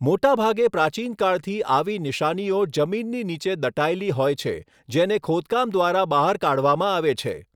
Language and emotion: Gujarati, neutral